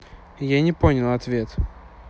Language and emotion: Russian, neutral